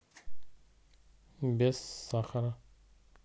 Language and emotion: Russian, neutral